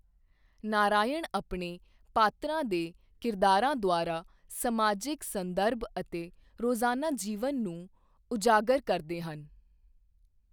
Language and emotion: Punjabi, neutral